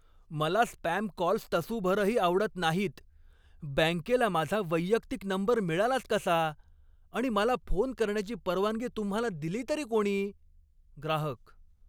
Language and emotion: Marathi, angry